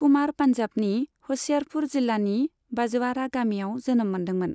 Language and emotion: Bodo, neutral